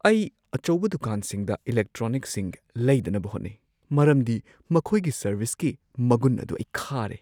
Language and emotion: Manipuri, fearful